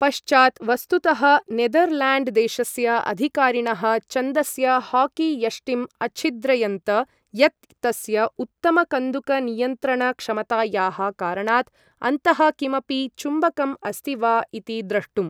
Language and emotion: Sanskrit, neutral